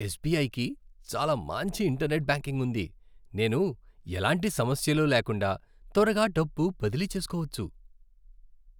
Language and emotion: Telugu, happy